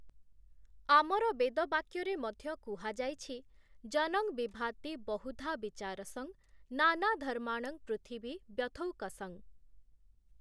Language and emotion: Odia, neutral